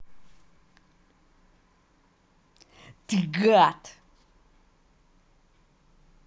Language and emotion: Russian, angry